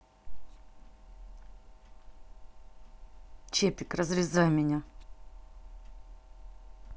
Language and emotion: Russian, angry